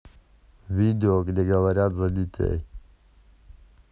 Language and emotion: Russian, neutral